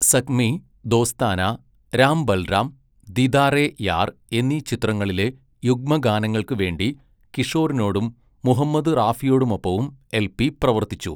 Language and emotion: Malayalam, neutral